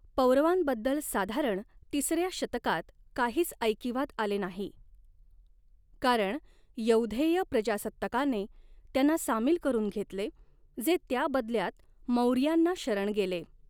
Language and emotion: Marathi, neutral